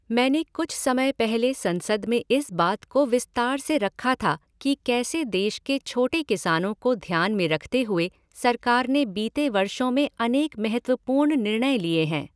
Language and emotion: Hindi, neutral